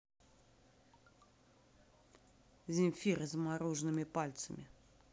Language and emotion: Russian, neutral